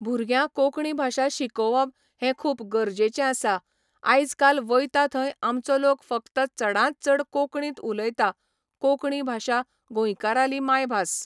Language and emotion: Goan Konkani, neutral